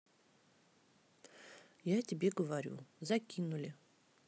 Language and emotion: Russian, neutral